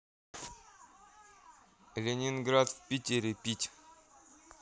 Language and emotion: Russian, neutral